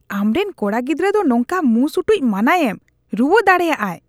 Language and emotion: Santali, disgusted